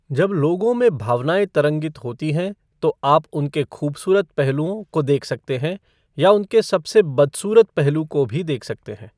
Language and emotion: Hindi, neutral